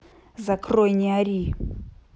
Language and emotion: Russian, angry